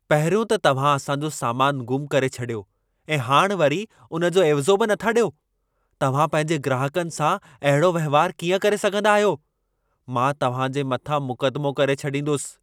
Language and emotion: Sindhi, angry